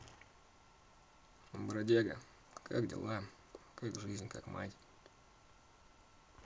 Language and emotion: Russian, neutral